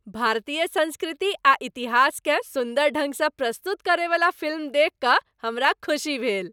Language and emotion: Maithili, happy